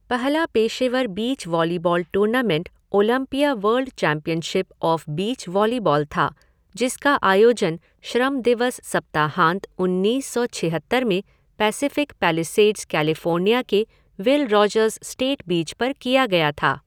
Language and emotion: Hindi, neutral